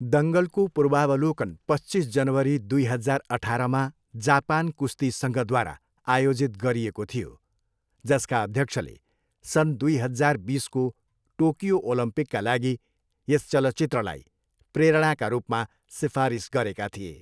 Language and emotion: Nepali, neutral